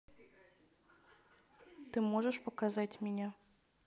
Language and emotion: Russian, neutral